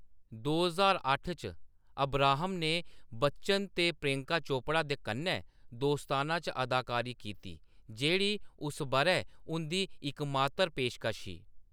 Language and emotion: Dogri, neutral